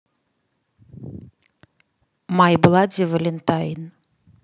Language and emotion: Russian, neutral